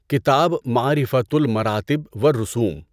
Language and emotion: Urdu, neutral